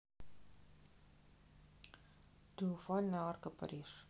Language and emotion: Russian, neutral